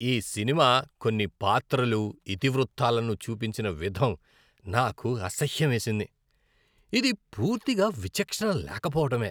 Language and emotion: Telugu, disgusted